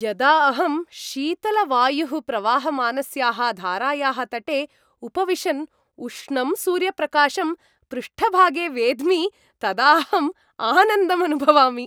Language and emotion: Sanskrit, happy